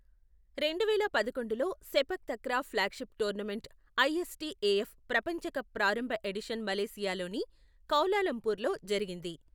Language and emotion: Telugu, neutral